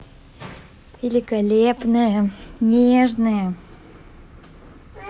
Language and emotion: Russian, positive